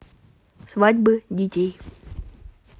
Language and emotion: Russian, neutral